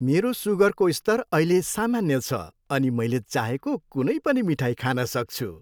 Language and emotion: Nepali, happy